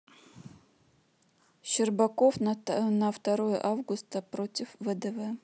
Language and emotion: Russian, neutral